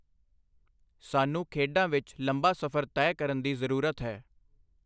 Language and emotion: Punjabi, neutral